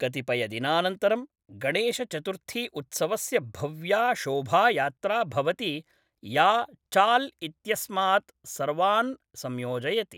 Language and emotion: Sanskrit, neutral